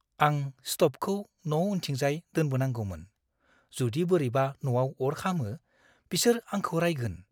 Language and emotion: Bodo, fearful